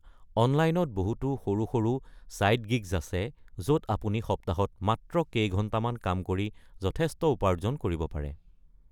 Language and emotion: Assamese, neutral